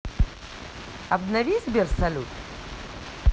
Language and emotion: Russian, neutral